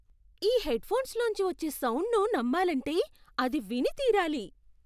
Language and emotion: Telugu, surprised